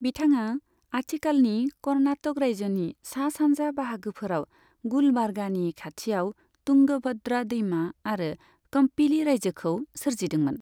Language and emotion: Bodo, neutral